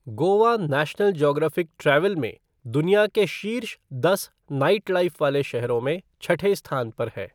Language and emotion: Hindi, neutral